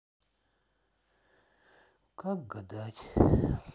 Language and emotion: Russian, sad